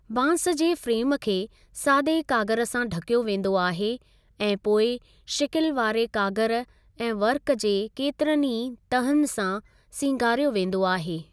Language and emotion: Sindhi, neutral